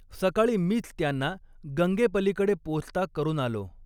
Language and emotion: Marathi, neutral